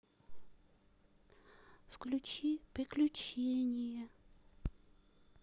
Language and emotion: Russian, sad